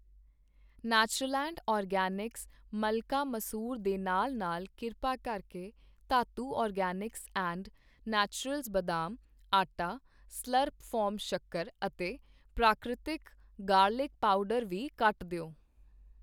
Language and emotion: Punjabi, neutral